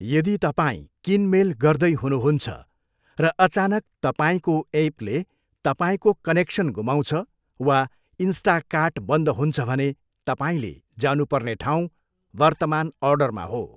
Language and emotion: Nepali, neutral